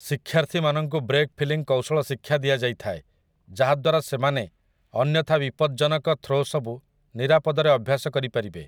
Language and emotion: Odia, neutral